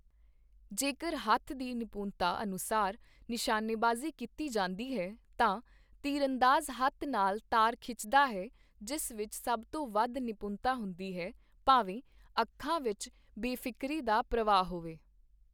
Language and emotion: Punjabi, neutral